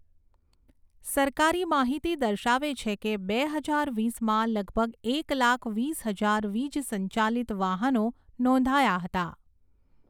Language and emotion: Gujarati, neutral